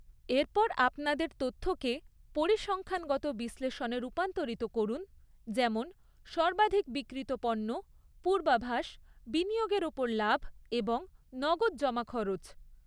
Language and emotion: Bengali, neutral